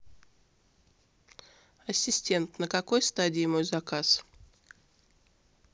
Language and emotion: Russian, neutral